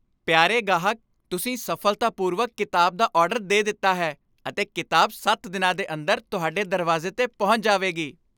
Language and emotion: Punjabi, happy